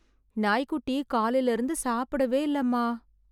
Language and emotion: Tamil, sad